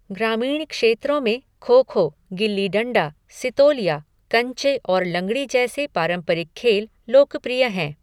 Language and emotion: Hindi, neutral